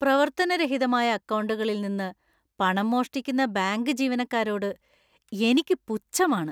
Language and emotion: Malayalam, disgusted